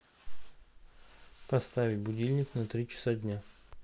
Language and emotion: Russian, neutral